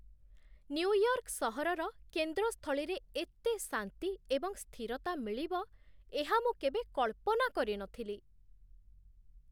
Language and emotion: Odia, surprised